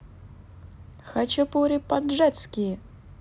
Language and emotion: Russian, positive